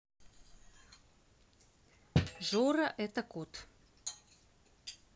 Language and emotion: Russian, neutral